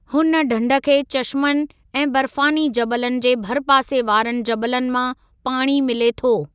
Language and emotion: Sindhi, neutral